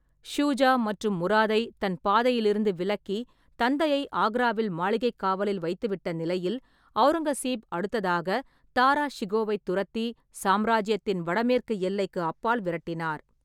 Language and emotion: Tamil, neutral